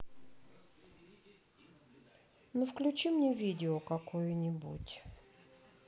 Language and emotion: Russian, sad